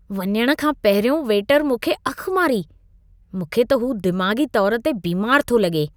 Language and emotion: Sindhi, disgusted